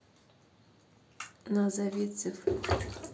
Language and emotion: Russian, neutral